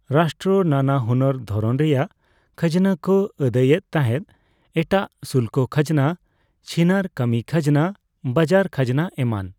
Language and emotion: Santali, neutral